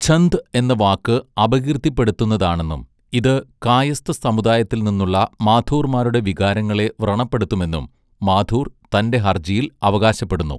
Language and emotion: Malayalam, neutral